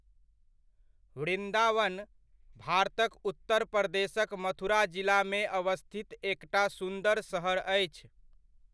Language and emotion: Maithili, neutral